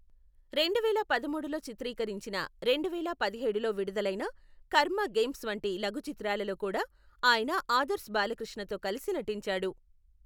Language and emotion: Telugu, neutral